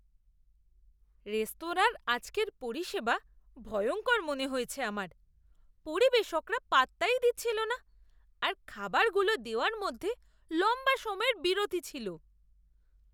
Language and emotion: Bengali, disgusted